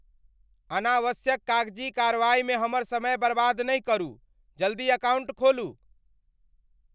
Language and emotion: Maithili, angry